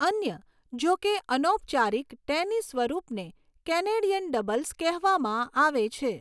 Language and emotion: Gujarati, neutral